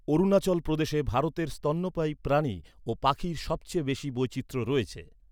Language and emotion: Bengali, neutral